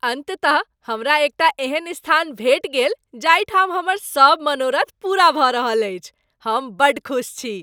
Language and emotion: Maithili, happy